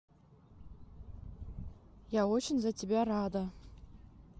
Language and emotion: Russian, neutral